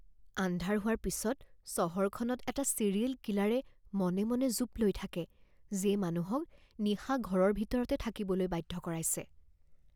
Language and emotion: Assamese, fearful